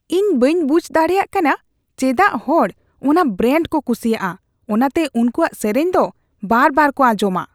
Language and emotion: Santali, disgusted